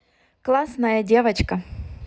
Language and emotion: Russian, positive